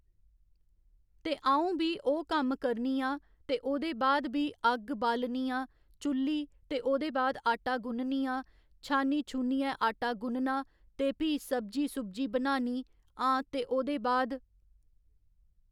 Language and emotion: Dogri, neutral